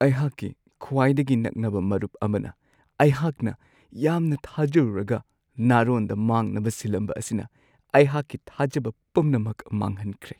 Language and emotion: Manipuri, sad